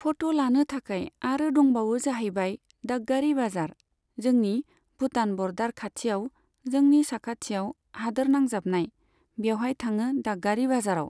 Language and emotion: Bodo, neutral